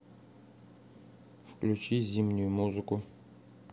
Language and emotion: Russian, neutral